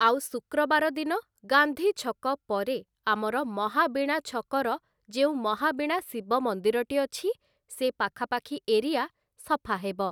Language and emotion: Odia, neutral